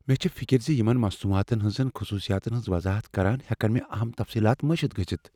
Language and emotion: Kashmiri, fearful